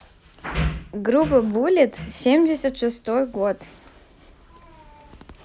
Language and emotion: Russian, neutral